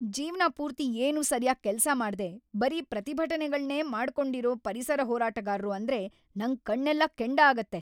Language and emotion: Kannada, angry